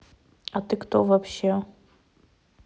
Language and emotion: Russian, neutral